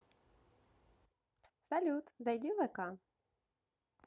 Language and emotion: Russian, positive